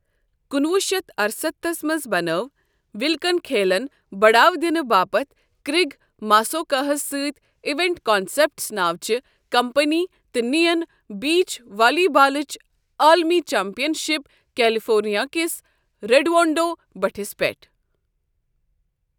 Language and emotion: Kashmiri, neutral